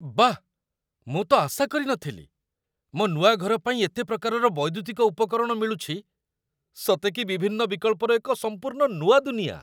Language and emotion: Odia, surprised